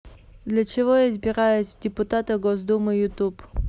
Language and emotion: Russian, neutral